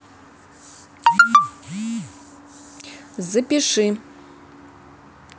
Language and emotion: Russian, neutral